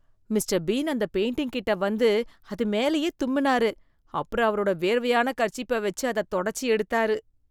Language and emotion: Tamil, disgusted